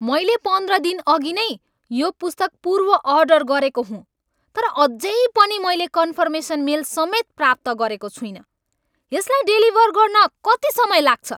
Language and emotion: Nepali, angry